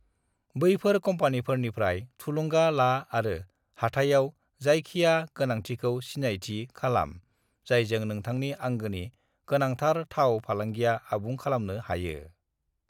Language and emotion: Bodo, neutral